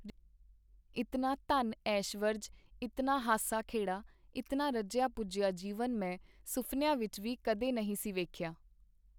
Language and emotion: Punjabi, neutral